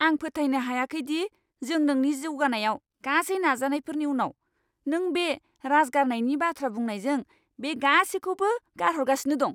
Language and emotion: Bodo, angry